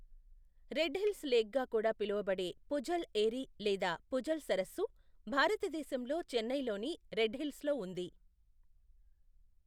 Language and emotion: Telugu, neutral